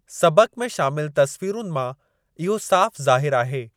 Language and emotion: Sindhi, neutral